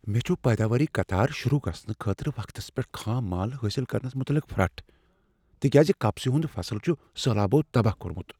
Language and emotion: Kashmiri, fearful